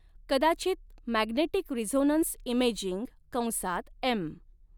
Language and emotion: Marathi, neutral